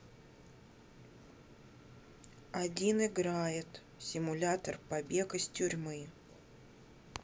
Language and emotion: Russian, neutral